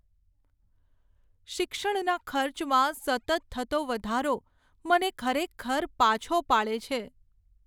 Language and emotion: Gujarati, sad